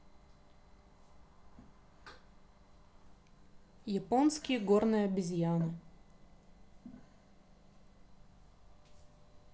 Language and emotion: Russian, neutral